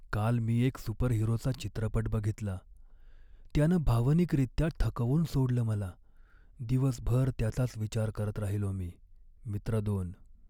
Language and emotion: Marathi, sad